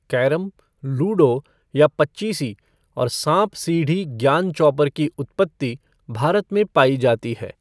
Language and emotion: Hindi, neutral